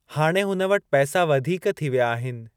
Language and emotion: Sindhi, neutral